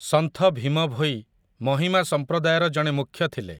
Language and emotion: Odia, neutral